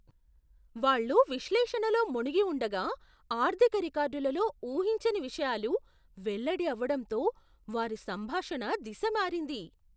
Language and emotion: Telugu, surprised